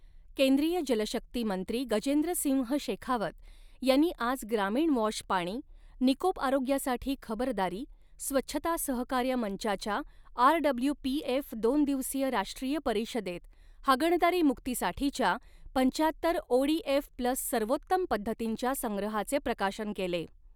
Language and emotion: Marathi, neutral